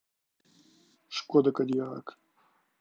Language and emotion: Russian, neutral